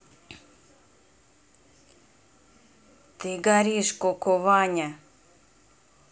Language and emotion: Russian, angry